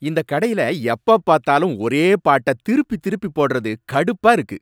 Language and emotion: Tamil, angry